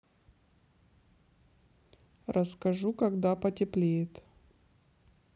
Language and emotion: Russian, neutral